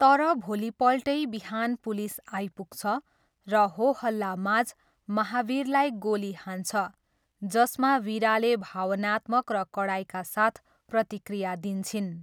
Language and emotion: Nepali, neutral